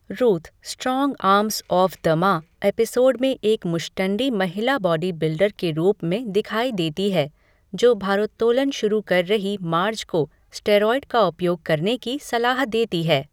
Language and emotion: Hindi, neutral